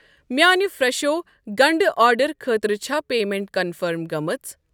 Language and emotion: Kashmiri, neutral